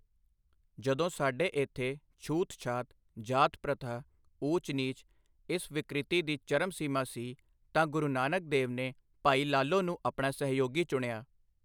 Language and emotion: Punjabi, neutral